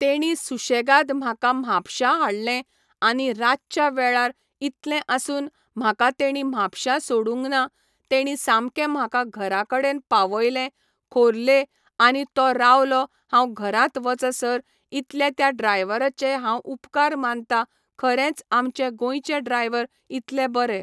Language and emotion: Goan Konkani, neutral